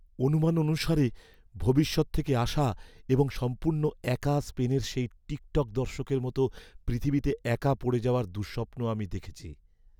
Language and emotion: Bengali, fearful